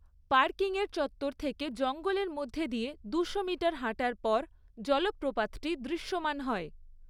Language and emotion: Bengali, neutral